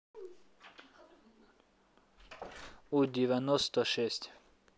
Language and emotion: Russian, neutral